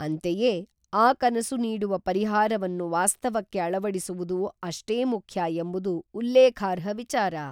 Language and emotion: Kannada, neutral